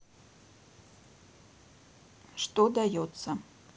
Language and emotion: Russian, neutral